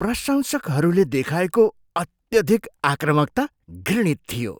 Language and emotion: Nepali, disgusted